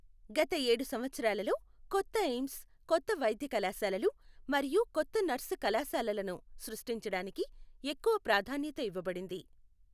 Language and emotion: Telugu, neutral